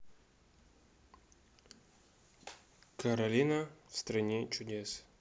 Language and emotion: Russian, neutral